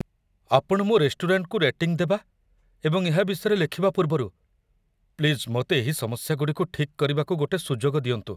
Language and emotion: Odia, fearful